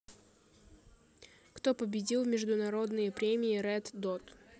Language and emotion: Russian, neutral